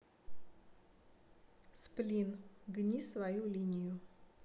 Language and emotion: Russian, neutral